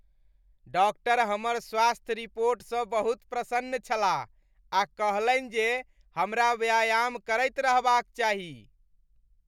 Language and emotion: Maithili, happy